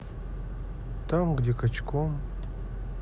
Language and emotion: Russian, neutral